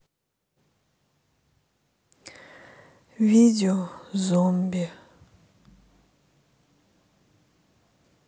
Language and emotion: Russian, sad